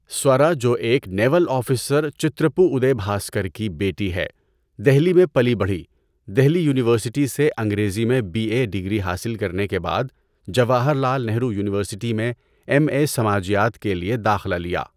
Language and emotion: Urdu, neutral